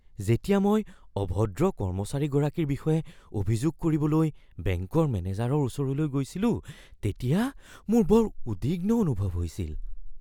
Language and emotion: Assamese, fearful